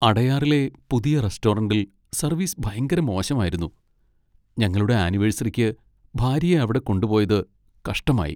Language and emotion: Malayalam, sad